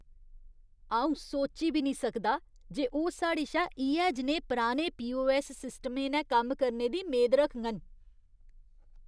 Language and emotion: Dogri, disgusted